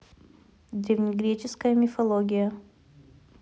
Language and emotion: Russian, neutral